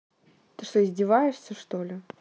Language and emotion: Russian, angry